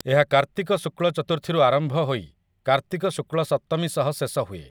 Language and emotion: Odia, neutral